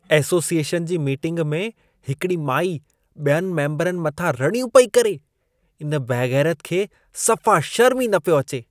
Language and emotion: Sindhi, disgusted